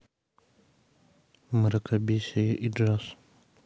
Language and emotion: Russian, neutral